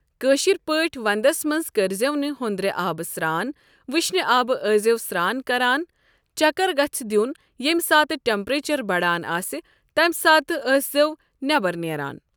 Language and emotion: Kashmiri, neutral